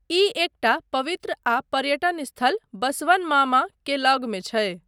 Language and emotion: Maithili, neutral